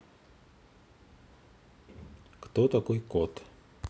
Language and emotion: Russian, neutral